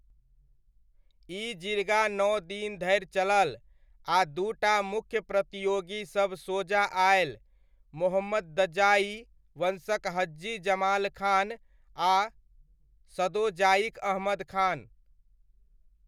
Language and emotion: Maithili, neutral